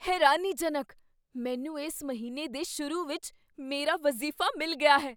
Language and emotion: Punjabi, surprised